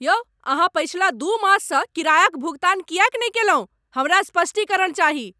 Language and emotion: Maithili, angry